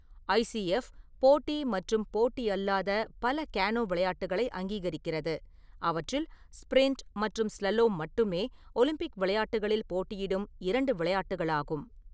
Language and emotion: Tamil, neutral